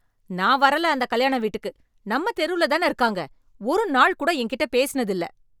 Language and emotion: Tamil, angry